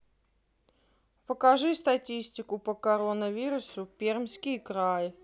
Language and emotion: Russian, neutral